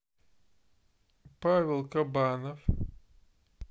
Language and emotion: Russian, neutral